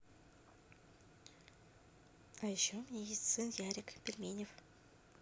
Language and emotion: Russian, neutral